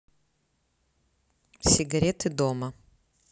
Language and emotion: Russian, neutral